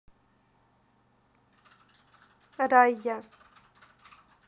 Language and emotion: Russian, neutral